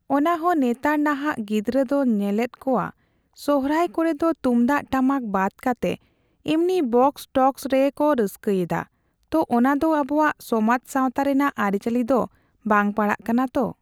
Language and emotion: Santali, neutral